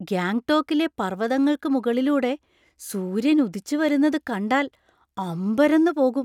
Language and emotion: Malayalam, surprised